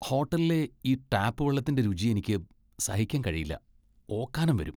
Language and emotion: Malayalam, disgusted